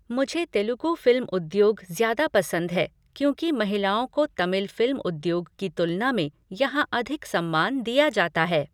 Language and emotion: Hindi, neutral